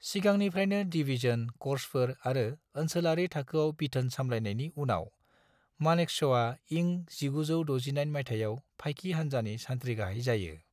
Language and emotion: Bodo, neutral